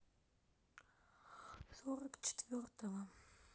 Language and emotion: Russian, sad